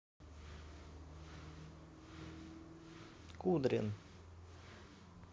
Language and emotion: Russian, neutral